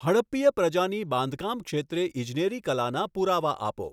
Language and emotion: Gujarati, neutral